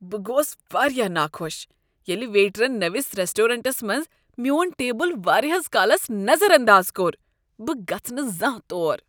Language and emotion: Kashmiri, disgusted